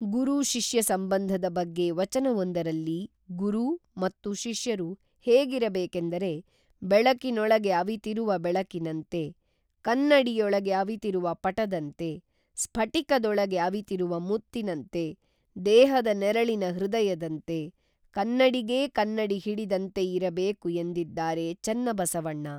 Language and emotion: Kannada, neutral